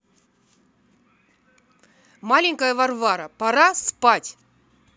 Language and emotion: Russian, angry